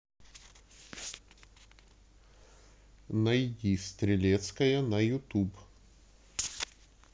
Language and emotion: Russian, neutral